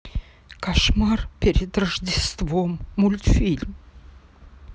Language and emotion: Russian, sad